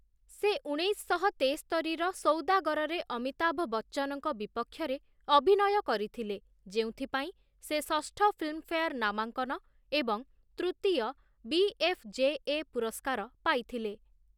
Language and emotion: Odia, neutral